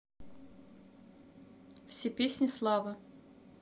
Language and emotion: Russian, neutral